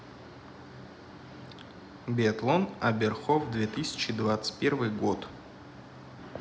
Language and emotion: Russian, neutral